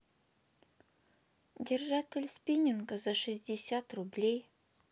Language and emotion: Russian, neutral